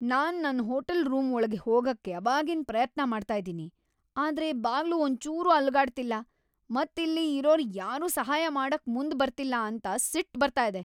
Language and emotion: Kannada, angry